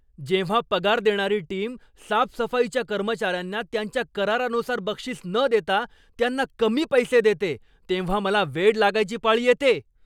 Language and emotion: Marathi, angry